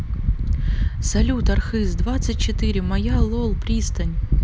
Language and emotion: Russian, neutral